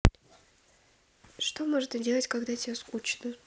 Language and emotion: Russian, neutral